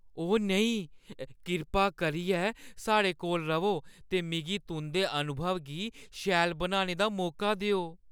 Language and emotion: Dogri, fearful